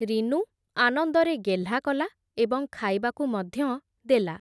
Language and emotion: Odia, neutral